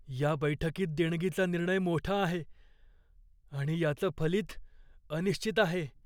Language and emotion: Marathi, fearful